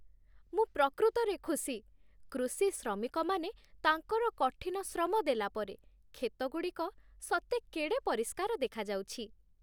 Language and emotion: Odia, happy